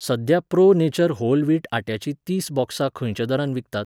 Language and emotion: Goan Konkani, neutral